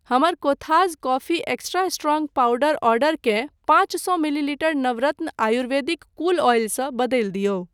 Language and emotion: Maithili, neutral